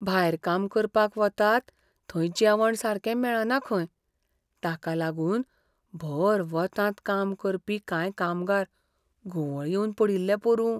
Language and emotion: Goan Konkani, fearful